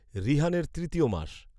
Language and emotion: Bengali, neutral